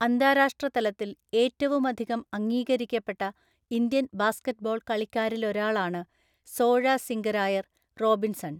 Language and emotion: Malayalam, neutral